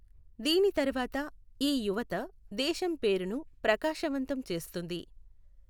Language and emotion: Telugu, neutral